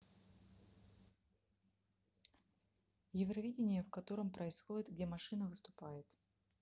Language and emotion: Russian, neutral